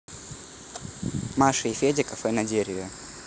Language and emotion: Russian, neutral